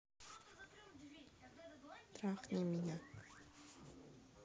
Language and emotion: Russian, neutral